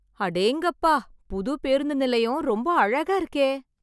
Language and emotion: Tamil, surprised